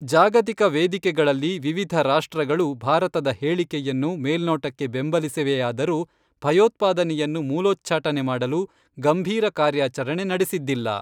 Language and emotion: Kannada, neutral